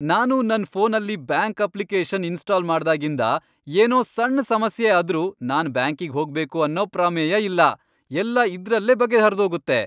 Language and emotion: Kannada, happy